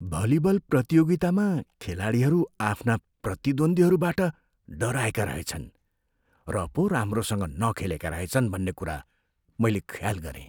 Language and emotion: Nepali, fearful